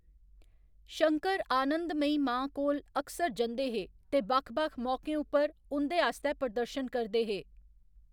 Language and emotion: Dogri, neutral